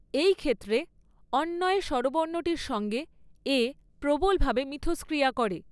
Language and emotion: Bengali, neutral